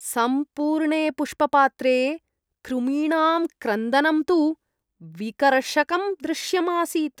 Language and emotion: Sanskrit, disgusted